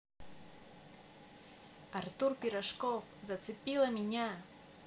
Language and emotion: Russian, positive